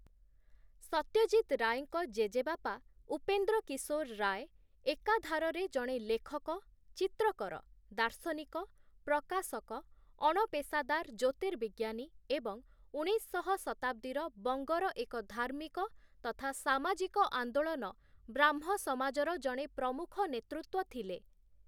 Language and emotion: Odia, neutral